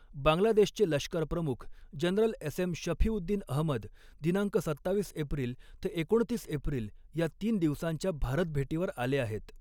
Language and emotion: Marathi, neutral